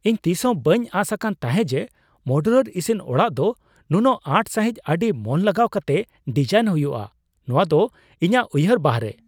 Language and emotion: Santali, surprised